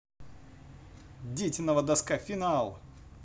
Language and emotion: Russian, positive